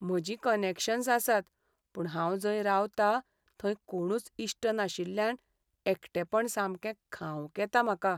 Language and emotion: Goan Konkani, sad